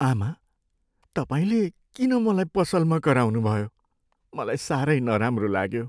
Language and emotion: Nepali, sad